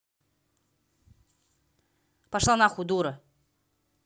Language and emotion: Russian, angry